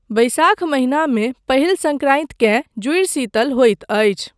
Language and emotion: Maithili, neutral